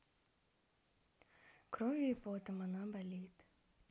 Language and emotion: Russian, sad